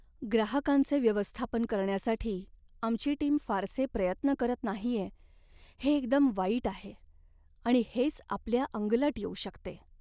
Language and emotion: Marathi, sad